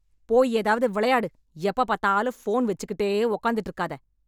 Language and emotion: Tamil, angry